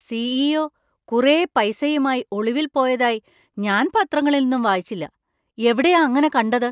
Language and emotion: Malayalam, surprised